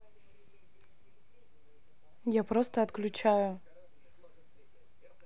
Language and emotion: Russian, neutral